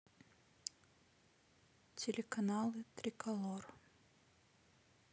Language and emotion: Russian, neutral